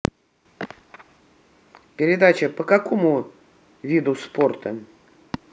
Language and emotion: Russian, neutral